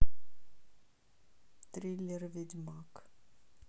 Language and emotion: Russian, neutral